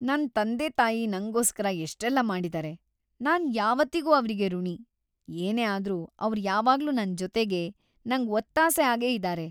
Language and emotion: Kannada, happy